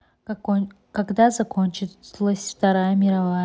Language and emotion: Russian, neutral